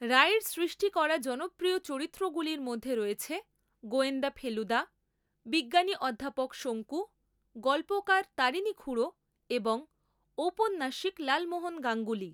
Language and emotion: Bengali, neutral